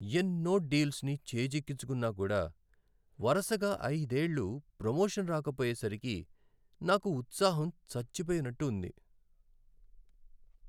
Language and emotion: Telugu, sad